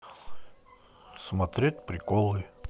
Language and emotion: Russian, neutral